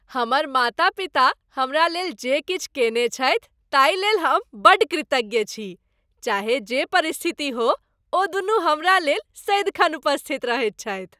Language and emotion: Maithili, happy